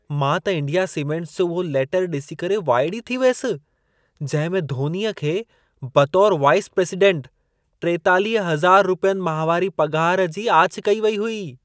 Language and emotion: Sindhi, surprised